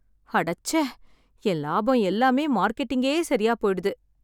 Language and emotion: Tamil, sad